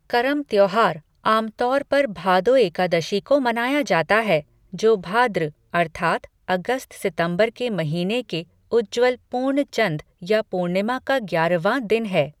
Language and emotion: Hindi, neutral